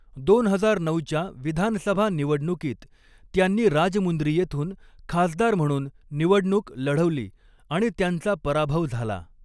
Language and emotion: Marathi, neutral